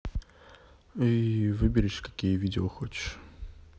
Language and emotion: Russian, neutral